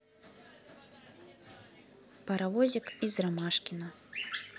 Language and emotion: Russian, neutral